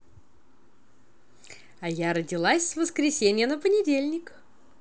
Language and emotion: Russian, positive